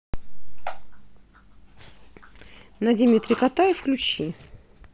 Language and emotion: Russian, neutral